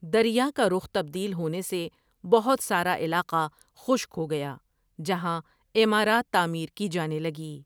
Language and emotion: Urdu, neutral